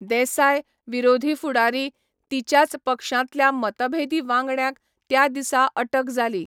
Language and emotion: Goan Konkani, neutral